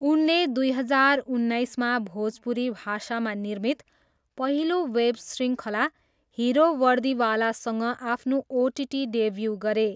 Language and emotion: Nepali, neutral